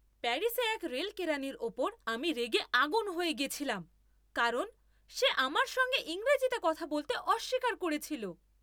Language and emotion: Bengali, angry